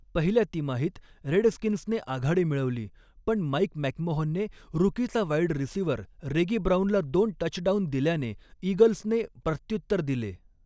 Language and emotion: Marathi, neutral